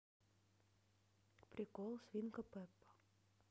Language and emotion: Russian, neutral